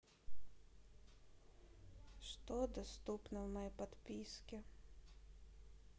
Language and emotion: Russian, sad